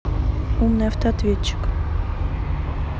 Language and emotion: Russian, neutral